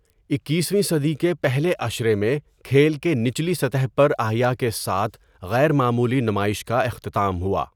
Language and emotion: Urdu, neutral